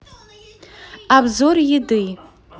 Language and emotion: Russian, neutral